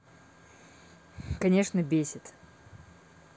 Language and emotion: Russian, neutral